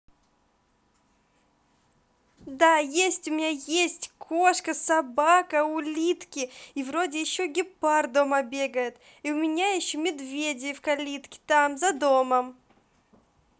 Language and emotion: Russian, positive